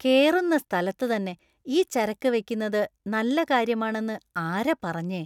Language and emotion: Malayalam, disgusted